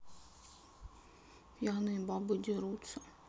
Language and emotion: Russian, sad